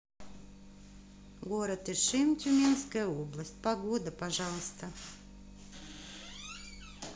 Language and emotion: Russian, positive